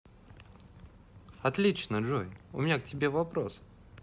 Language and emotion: Russian, positive